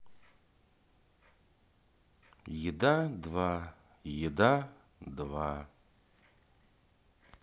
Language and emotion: Russian, sad